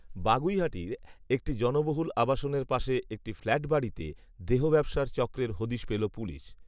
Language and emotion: Bengali, neutral